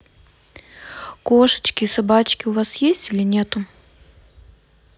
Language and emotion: Russian, neutral